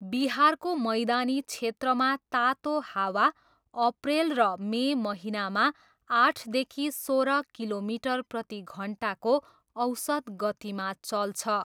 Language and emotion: Nepali, neutral